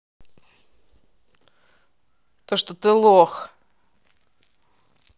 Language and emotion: Russian, angry